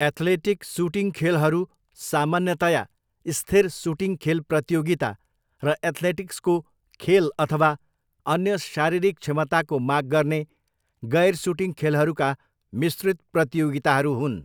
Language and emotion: Nepali, neutral